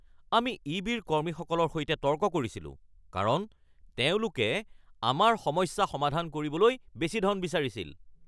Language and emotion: Assamese, angry